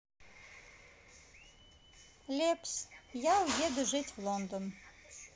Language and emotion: Russian, neutral